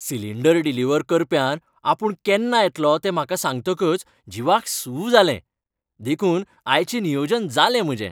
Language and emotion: Goan Konkani, happy